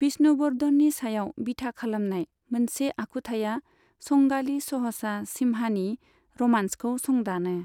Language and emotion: Bodo, neutral